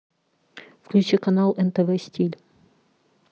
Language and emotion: Russian, neutral